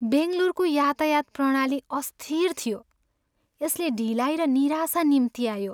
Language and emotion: Nepali, sad